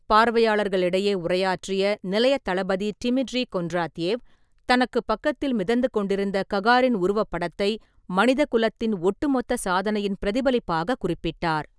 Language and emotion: Tamil, neutral